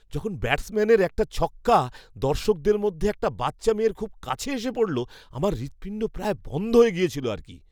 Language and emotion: Bengali, surprised